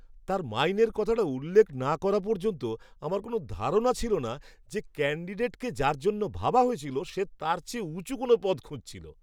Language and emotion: Bengali, surprised